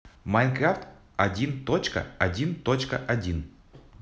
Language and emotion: Russian, neutral